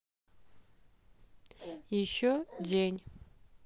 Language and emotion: Russian, neutral